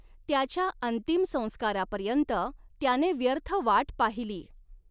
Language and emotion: Marathi, neutral